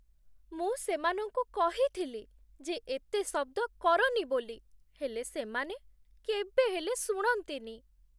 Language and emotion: Odia, sad